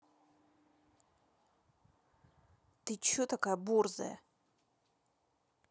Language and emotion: Russian, angry